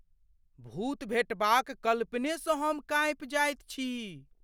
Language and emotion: Maithili, fearful